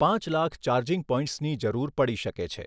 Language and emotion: Gujarati, neutral